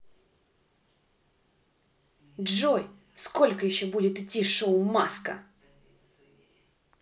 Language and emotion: Russian, angry